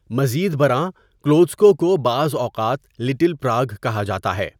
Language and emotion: Urdu, neutral